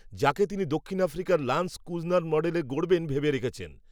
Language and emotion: Bengali, neutral